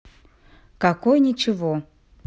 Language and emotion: Russian, neutral